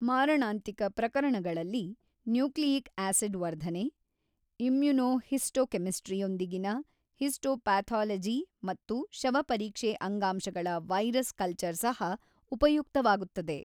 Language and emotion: Kannada, neutral